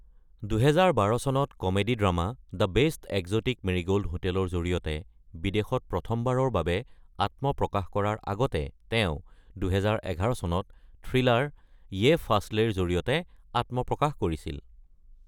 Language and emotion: Assamese, neutral